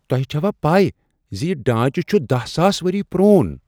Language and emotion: Kashmiri, surprised